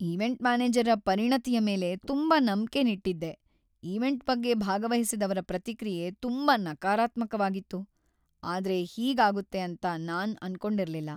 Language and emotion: Kannada, sad